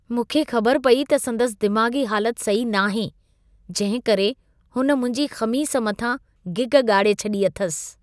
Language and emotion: Sindhi, disgusted